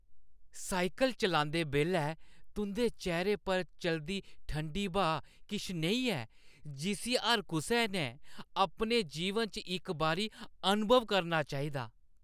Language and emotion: Dogri, happy